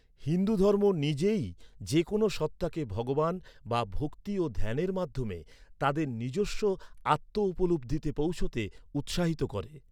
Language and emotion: Bengali, neutral